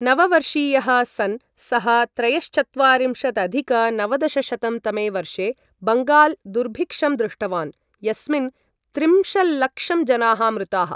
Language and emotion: Sanskrit, neutral